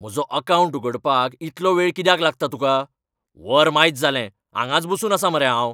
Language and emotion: Goan Konkani, angry